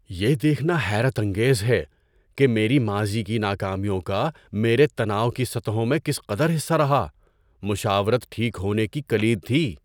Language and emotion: Urdu, surprised